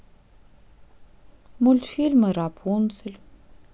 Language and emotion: Russian, sad